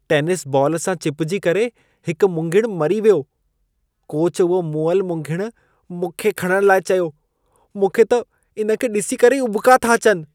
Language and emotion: Sindhi, disgusted